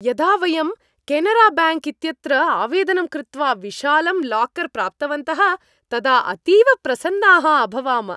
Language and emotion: Sanskrit, happy